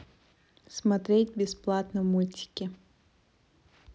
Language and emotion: Russian, neutral